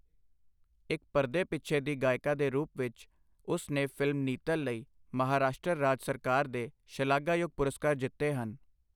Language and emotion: Punjabi, neutral